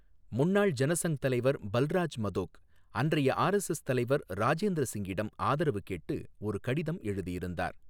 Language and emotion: Tamil, neutral